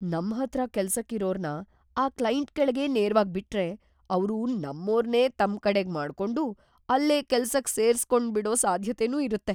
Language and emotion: Kannada, fearful